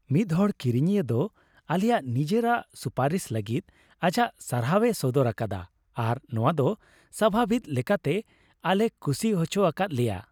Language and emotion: Santali, happy